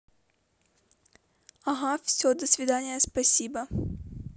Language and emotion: Russian, neutral